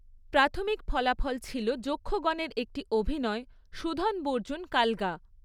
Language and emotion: Bengali, neutral